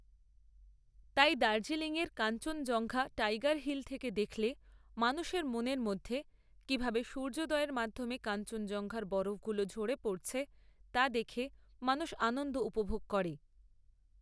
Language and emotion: Bengali, neutral